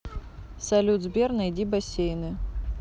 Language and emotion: Russian, neutral